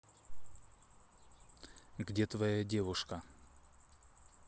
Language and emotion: Russian, neutral